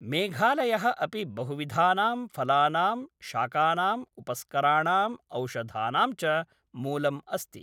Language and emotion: Sanskrit, neutral